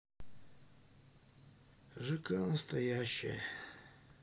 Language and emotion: Russian, sad